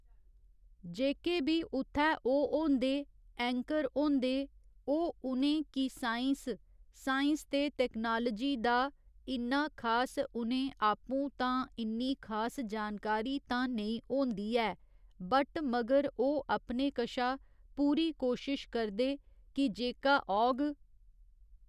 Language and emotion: Dogri, neutral